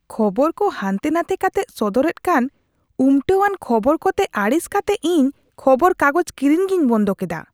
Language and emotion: Santali, disgusted